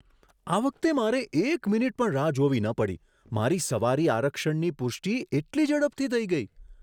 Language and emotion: Gujarati, surprised